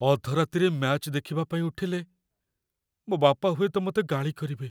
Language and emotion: Odia, fearful